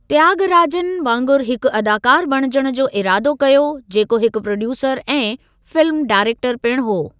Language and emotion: Sindhi, neutral